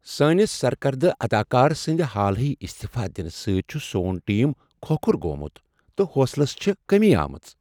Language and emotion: Kashmiri, sad